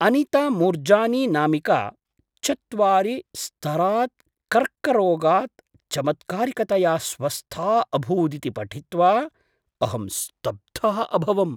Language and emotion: Sanskrit, surprised